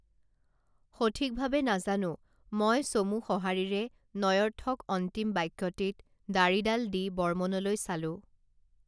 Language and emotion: Assamese, neutral